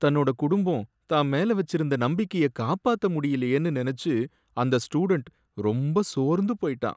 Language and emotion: Tamil, sad